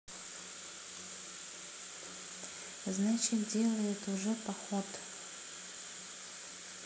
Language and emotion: Russian, sad